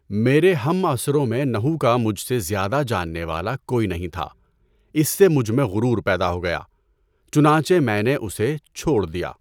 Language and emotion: Urdu, neutral